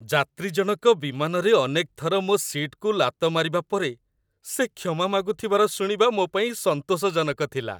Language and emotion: Odia, happy